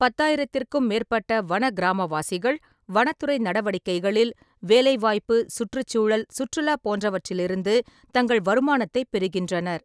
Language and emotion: Tamil, neutral